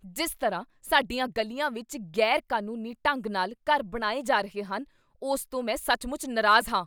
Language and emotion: Punjabi, angry